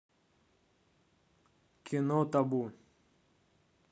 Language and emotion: Russian, neutral